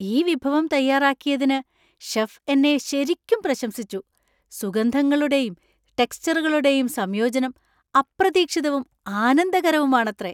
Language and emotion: Malayalam, surprised